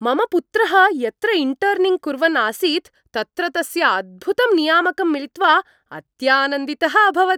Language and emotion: Sanskrit, happy